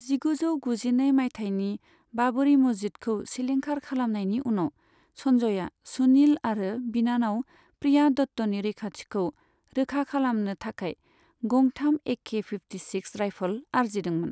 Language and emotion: Bodo, neutral